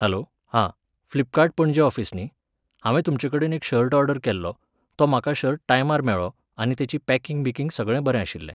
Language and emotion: Goan Konkani, neutral